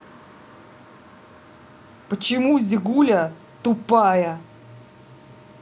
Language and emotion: Russian, angry